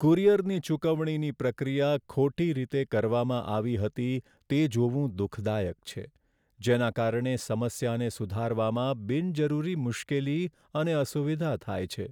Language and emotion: Gujarati, sad